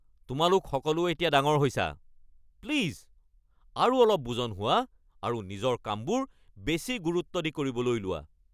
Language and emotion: Assamese, angry